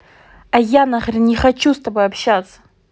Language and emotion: Russian, angry